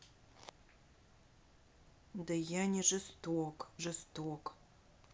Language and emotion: Russian, neutral